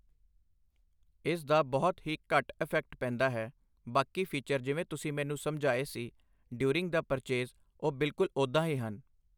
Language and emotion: Punjabi, neutral